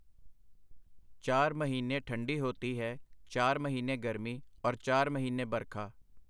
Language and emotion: Punjabi, neutral